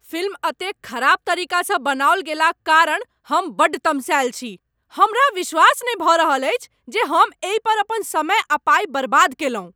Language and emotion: Maithili, angry